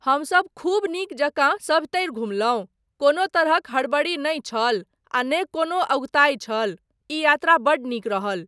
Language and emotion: Maithili, neutral